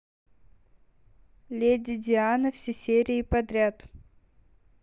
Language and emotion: Russian, neutral